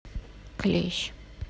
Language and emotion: Russian, neutral